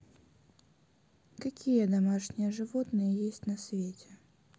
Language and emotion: Russian, neutral